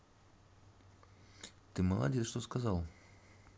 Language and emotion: Russian, neutral